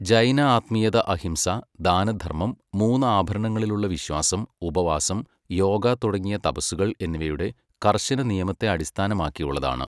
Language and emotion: Malayalam, neutral